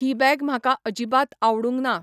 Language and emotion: Goan Konkani, neutral